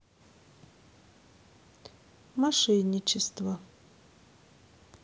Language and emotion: Russian, neutral